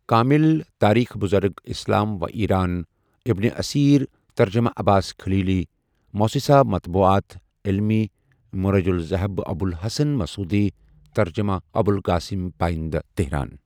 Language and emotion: Kashmiri, neutral